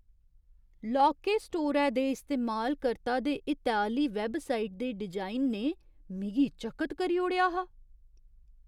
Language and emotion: Dogri, surprised